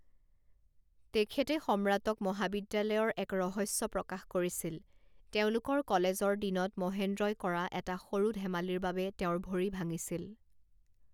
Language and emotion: Assamese, neutral